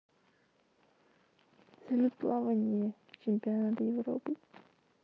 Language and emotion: Russian, sad